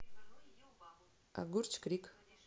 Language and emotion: Russian, neutral